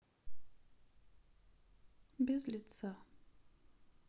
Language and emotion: Russian, sad